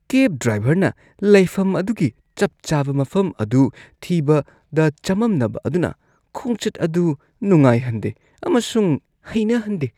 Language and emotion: Manipuri, disgusted